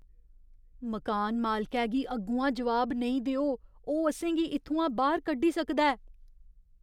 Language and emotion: Dogri, fearful